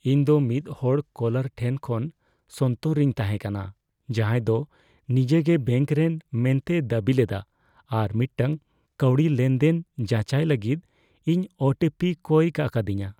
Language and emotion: Santali, fearful